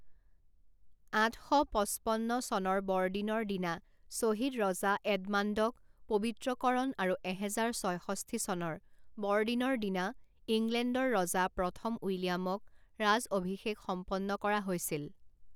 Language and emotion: Assamese, neutral